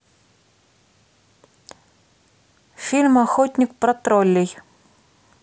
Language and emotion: Russian, neutral